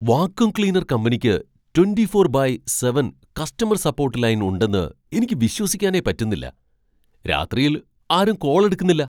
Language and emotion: Malayalam, surprised